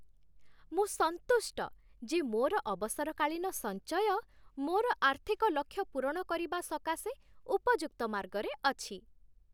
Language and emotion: Odia, happy